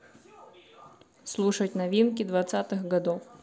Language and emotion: Russian, neutral